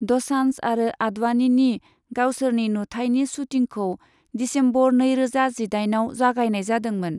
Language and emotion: Bodo, neutral